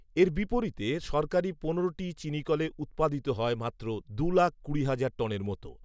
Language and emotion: Bengali, neutral